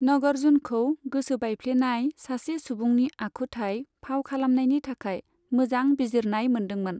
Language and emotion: Bodo, neutral